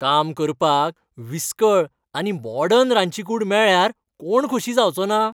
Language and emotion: Goan Konkani, happy